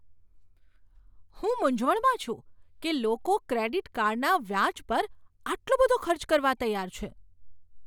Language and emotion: Gujarati, surprised